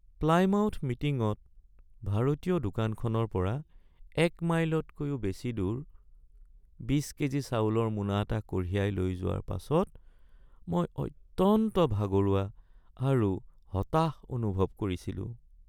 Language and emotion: Assamese, sad